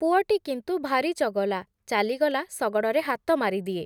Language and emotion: Odia, neutral